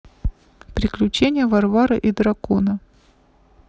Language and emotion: Russian, neutral